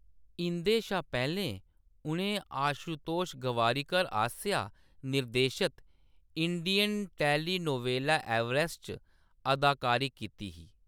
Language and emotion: Dogri, neutral